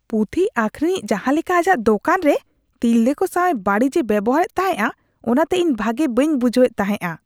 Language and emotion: Santali, disgusted